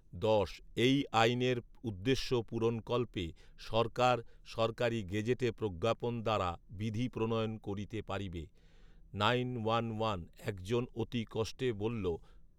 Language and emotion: Bengali, neutral